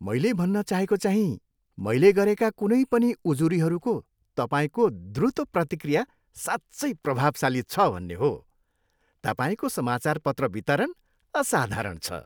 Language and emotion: Nepali, happy